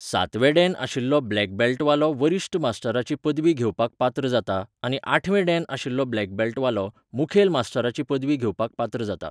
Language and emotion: Goan Konkani, neutral